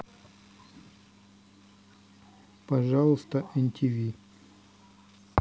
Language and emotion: Russian, neutral